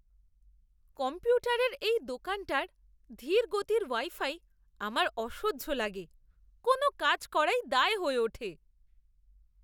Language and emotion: Bengali, disgusted